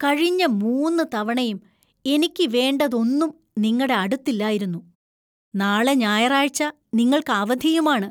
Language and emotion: Malayalam, disgusted